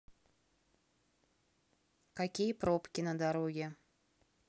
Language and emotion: Russian, neutral